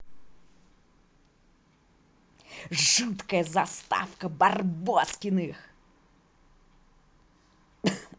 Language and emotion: Russian, positive